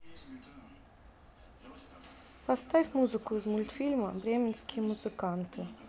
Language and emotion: Russian, neutral